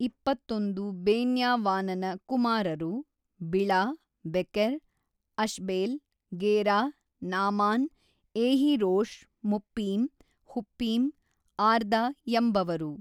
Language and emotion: Kannada, neutral